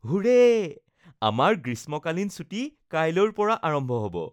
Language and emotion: Assamese, happy